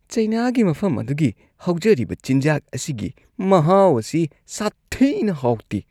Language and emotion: Manipuri, disgusted